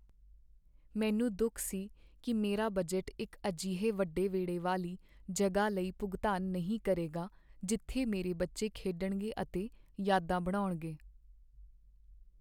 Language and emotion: Punjabi, sad